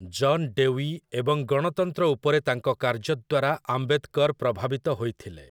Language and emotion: Odia, neutral